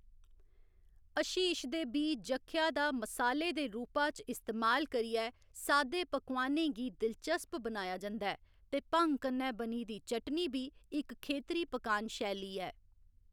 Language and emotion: Dogri, neutral